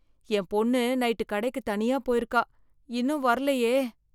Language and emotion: Tamil, fearful